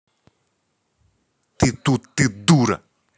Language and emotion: Russian, angry